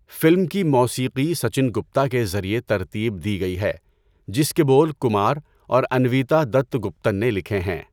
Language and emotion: Urdu, neutral